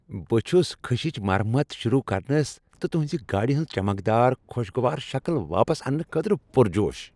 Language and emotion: Kashmiri, happy